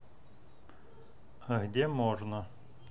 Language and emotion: Russian, neutral